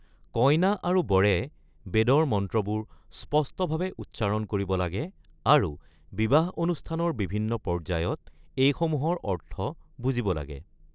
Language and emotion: Assamese, neutral